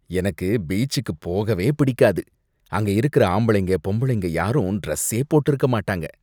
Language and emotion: Tamil, disgusted